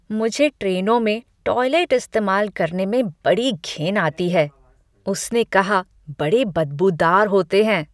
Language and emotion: Hindi, disgusted